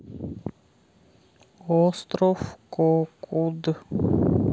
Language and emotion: Russian, neutral